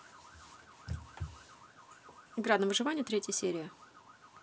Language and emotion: Russian, neutral